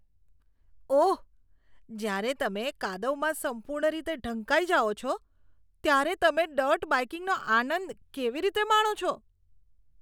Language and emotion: Gujarati, disgusted